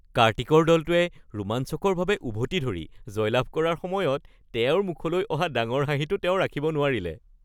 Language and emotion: Assamese, happy